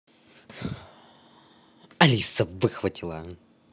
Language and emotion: Russian, angry